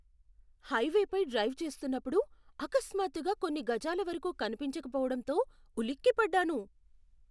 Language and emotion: Telugu, surprised